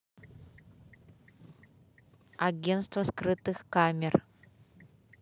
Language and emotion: Russian, neutral